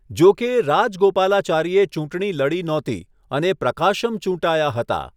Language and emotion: Gujarati, neutral